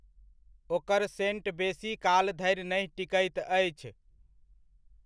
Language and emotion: Maithili, neutral